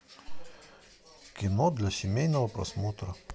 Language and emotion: Russian, neutral